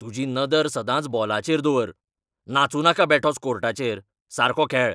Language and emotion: Goan Konkani, angry